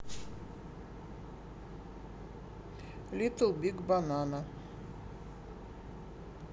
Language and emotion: Russian, neutral